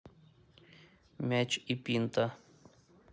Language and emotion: Russian, neutral